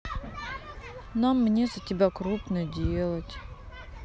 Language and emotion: Russian, sad